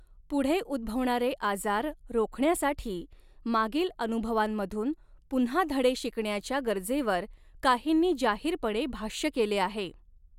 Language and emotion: Marathi, neutral